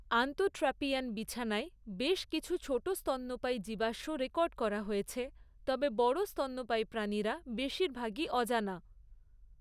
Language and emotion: Bengali, neutral